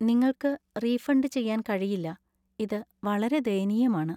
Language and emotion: Malayalam, sad